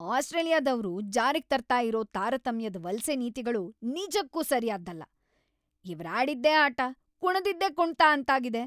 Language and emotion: Kannada, angry